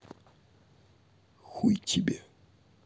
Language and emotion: Russian, neutral